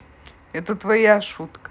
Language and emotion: Russian, neutral